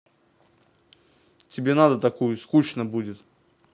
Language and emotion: Russian, neutral